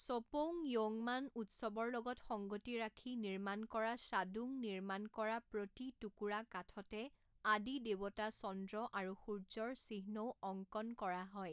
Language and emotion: Assamese, neutral